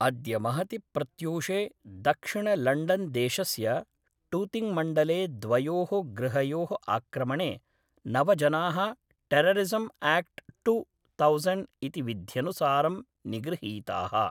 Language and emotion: Sanskrit, neutral